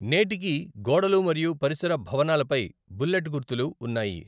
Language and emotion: Telugu, neutral